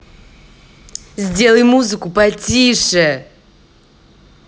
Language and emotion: Russian, angry